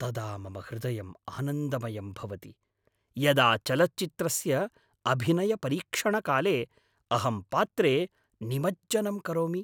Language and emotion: Sanskrit, happy